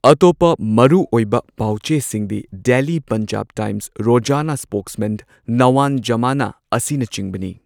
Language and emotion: Manipuri, neutral